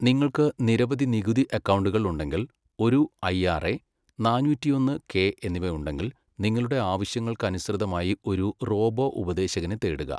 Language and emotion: Malayalam, neutral